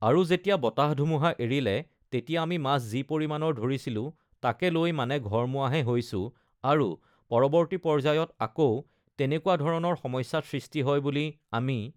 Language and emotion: Assamese, neutral